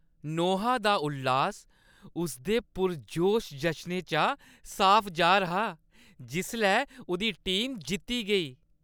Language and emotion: Dogri, happy